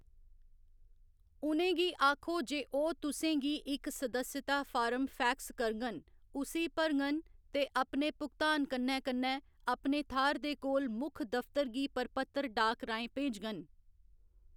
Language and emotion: Dogri, neutral